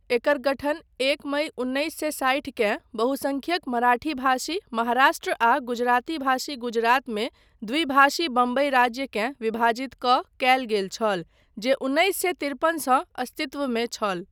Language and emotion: Maithili, neutral